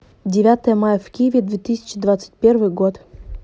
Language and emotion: Russian, neutral